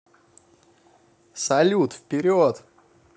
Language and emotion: Russian, positive